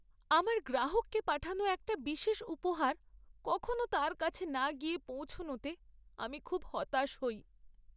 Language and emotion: Bengali, sad